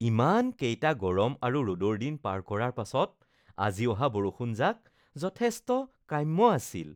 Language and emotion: Assamese, happy